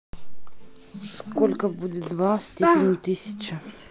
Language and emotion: Russian, neutral